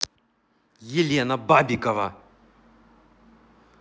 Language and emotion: Russian, angry